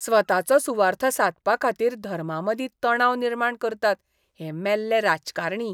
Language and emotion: Goan Konkani, disgusted